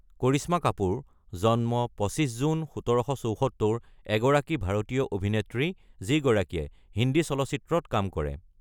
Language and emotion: Assamese, neutral